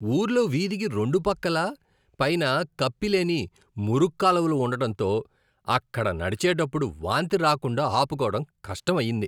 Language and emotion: Telugu, disgusted